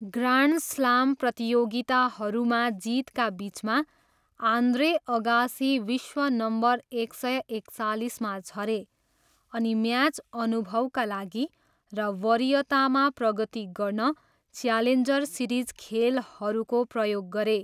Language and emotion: Nepali, neutral